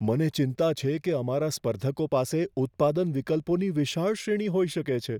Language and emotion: Gujarati, fearful